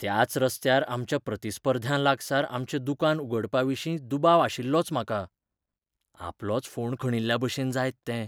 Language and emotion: Goan Konkani, fearful